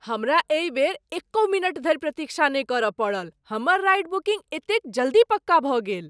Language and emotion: Maithili, surprised